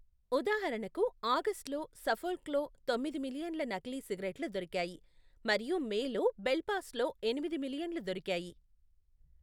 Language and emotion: Telugu, neutral